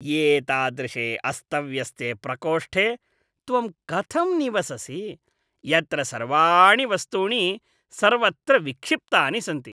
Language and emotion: Sanskrit, disgusted